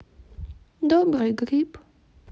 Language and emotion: Russian, sad